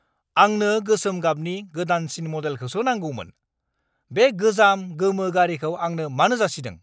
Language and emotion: Bodo, angry